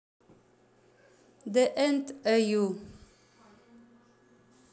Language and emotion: Russian, neutral